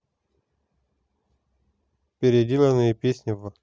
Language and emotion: Russian, neutral